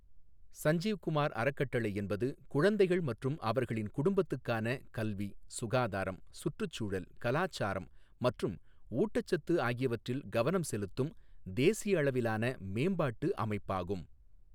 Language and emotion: Tamil, neutral